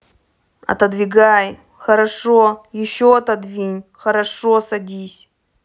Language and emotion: Russian, angry